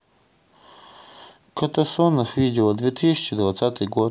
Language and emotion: Russian, neutral